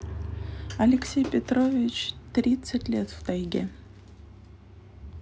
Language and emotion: Russian, neutral